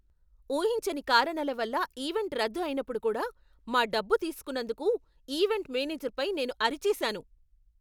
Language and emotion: Telugu, angry